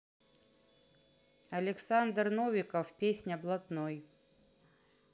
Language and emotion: Russian, neutral